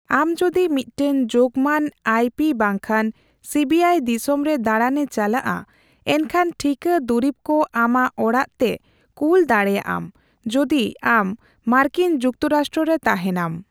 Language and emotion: Santali, neutral